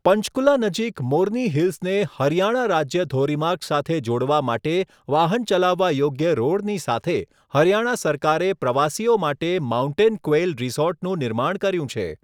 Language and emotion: Gujarati, neutral